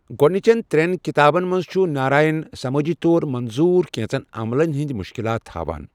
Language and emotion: Kashmiri, neutral